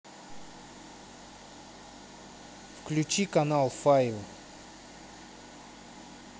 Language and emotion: Russian, neutral